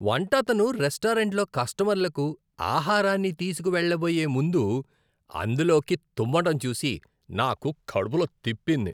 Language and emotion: Telugu, disgusted